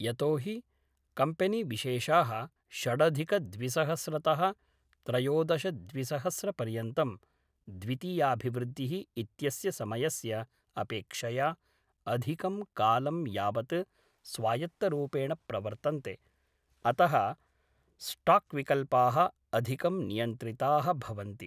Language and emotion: Sanskrit, neutral